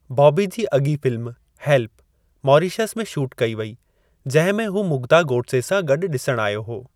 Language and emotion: Sindhi, neutral